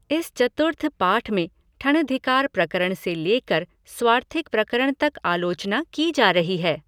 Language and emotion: Hindi, neutral